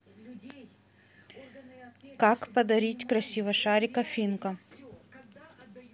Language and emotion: Russian, neutral